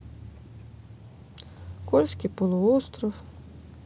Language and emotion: Russian, sad